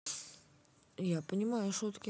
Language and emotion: Russian, neutral